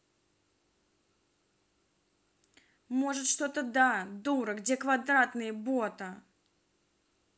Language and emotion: Russian, angry